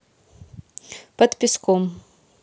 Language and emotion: Russian, neutral